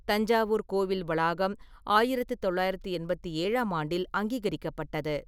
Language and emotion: Tamil, neutral